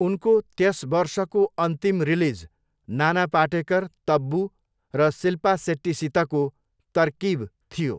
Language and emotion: Nepali, neutral